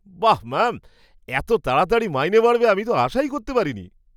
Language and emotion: Bengali, surprised